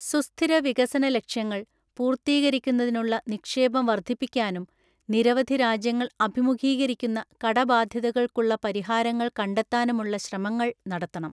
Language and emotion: Malayalam, neutral